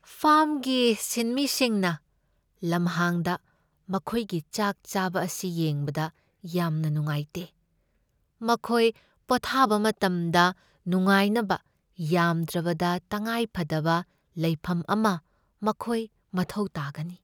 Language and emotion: Manipuri, sad